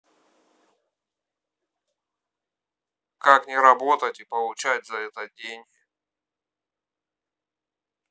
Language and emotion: Russian, neutral